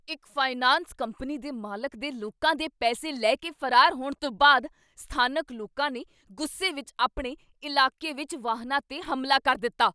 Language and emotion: Punjabi, angry